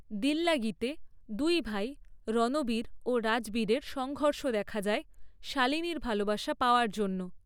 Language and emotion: Bengali, neutral